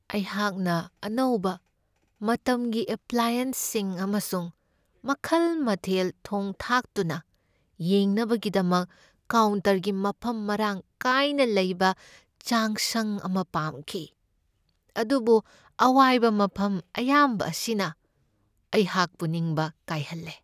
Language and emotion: Manipuri, sad